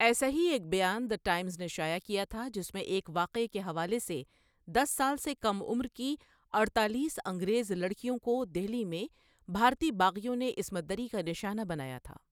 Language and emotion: Urdu, neutral